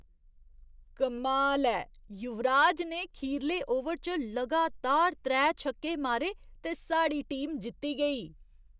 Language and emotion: Dogri, surprised